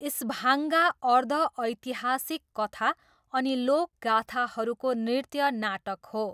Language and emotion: Nepali, neutral